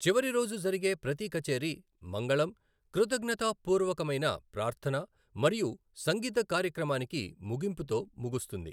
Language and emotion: Telugu, neutral